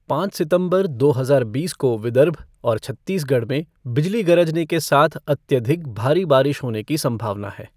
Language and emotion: Hindi, neutral